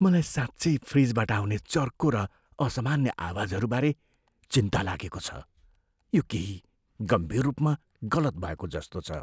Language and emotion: Nepali, fearful